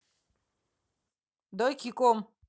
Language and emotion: Russian, neutral